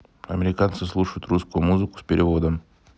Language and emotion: Russian, neutral